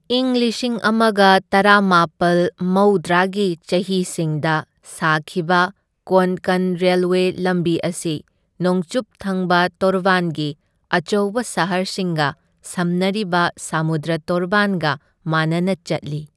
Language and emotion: Manipuri, neutral